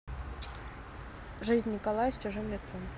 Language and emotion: Russian, neutral